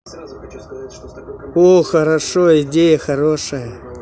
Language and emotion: Russian, positive